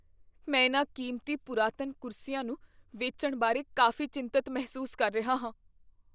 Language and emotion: Punjabi, fearful